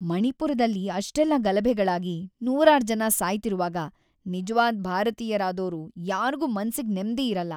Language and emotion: Kannada, sad